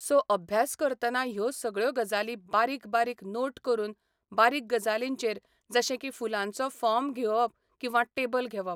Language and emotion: Goan Konkani, neutral